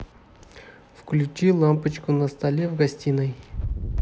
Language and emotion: Russian, neutral